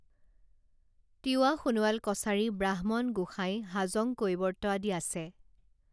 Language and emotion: Assamese, neutral